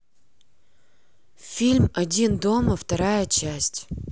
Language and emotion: Russian, neutral